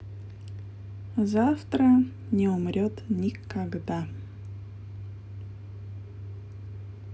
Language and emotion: Russian, positive